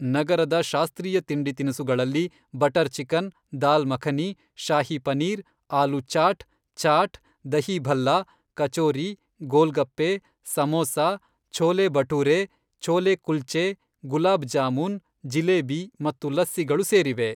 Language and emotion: Kannada, neutral